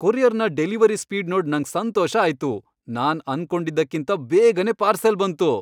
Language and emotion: Kannada, happy